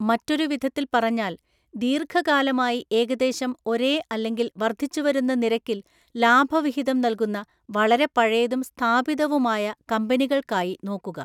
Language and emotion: Malayalam, neutral